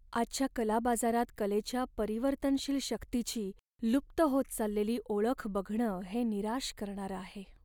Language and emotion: Marathi, sad